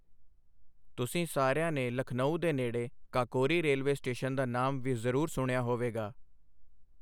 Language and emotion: Punjabi, neutral